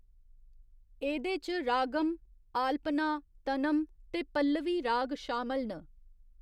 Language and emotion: Dogri, neutral